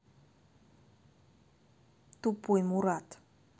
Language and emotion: Russian, neutral